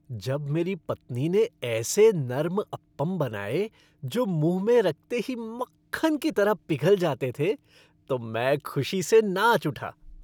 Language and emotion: Hindi, happy